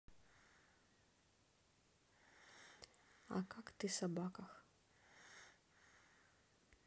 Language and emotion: Russian, neutral